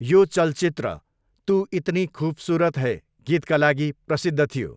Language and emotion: Nepali, neutral